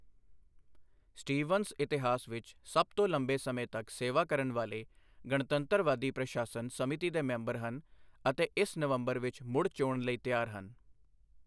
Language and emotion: Punjabi, neutral